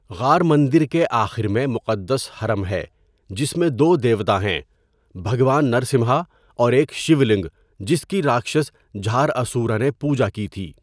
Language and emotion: Urdu, neutral